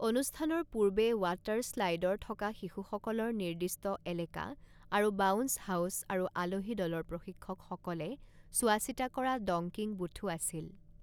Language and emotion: Assamese, neutral